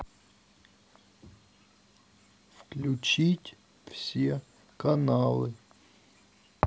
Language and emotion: Russian, neutral